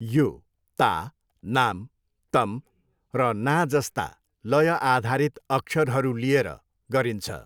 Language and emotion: Nepali, neutral